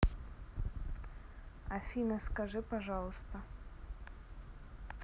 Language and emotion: Russian, neutral